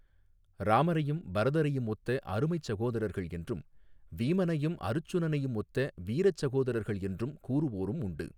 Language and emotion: Tamil, neutral